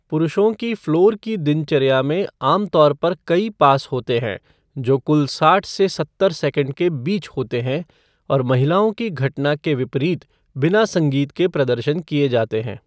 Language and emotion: Hindi, neutral